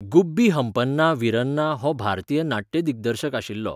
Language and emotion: Goan Konkani, neutral